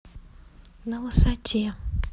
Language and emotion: Russian, neutral